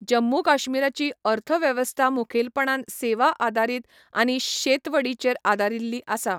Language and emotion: Goan Konkani, neutral